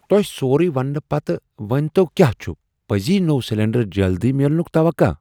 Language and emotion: Kashmiri, surprised